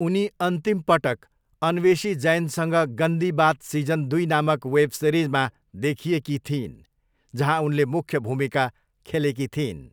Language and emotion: Nepali, neutral